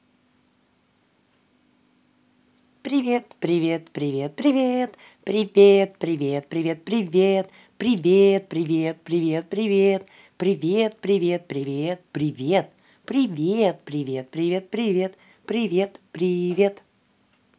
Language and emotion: Russian, positive